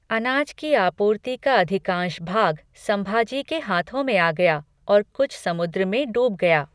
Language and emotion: Hindi, neutral